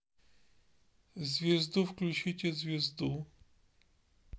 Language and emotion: Russian, neutral